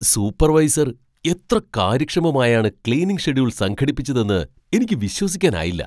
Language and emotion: Malayalam, surprised